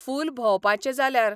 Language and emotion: Goan Konkani, neutral